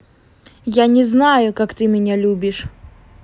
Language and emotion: Russian, angry